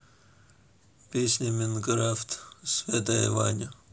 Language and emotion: Russian, neutral